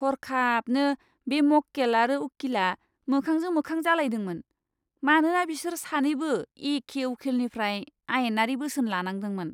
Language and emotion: Bodo, disgusted